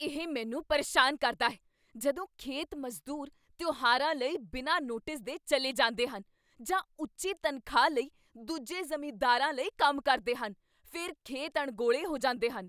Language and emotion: Punjabi, angry